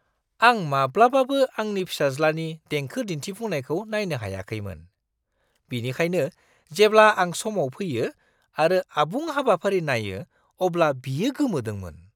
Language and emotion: Bodo, surprised